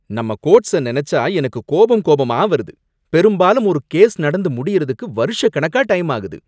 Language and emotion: Tamil, angry